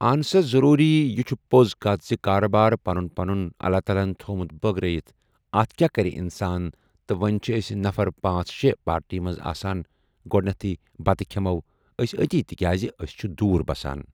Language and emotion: Kashmiri, neutral